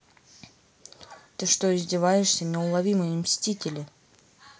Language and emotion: Russian, angry